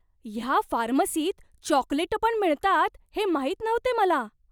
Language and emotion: Marathi, surprised